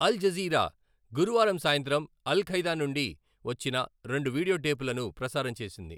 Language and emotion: Telugu, neutral